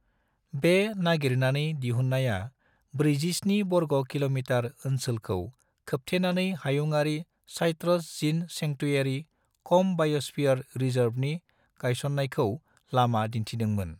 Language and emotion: Bodo, neutral